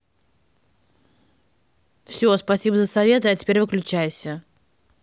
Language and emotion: Russian, angry